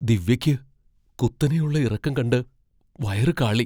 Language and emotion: Malayalam, fearful